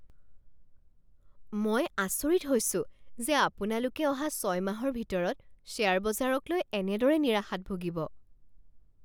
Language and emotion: Assamese, surprised